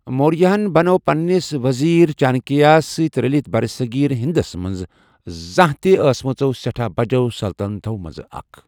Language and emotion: Kashmiri, neutral